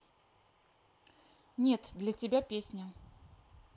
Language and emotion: Russian, neutral